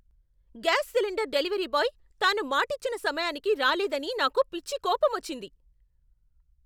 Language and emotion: Telugu, angry